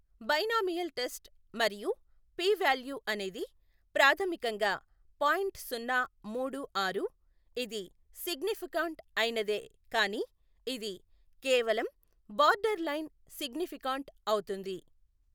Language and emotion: Telugu, neutral